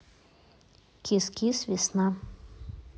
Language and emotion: Russian, neutral